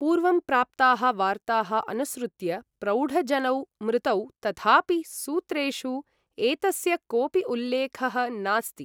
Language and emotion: Sanskrit, neutral